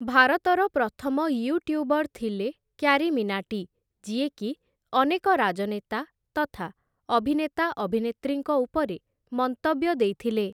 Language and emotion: Odia, neutral